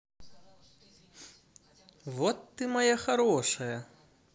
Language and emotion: Russian, positive